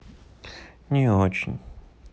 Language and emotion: Russian, sad